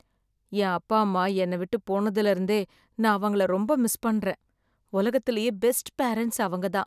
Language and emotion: Tamil, sad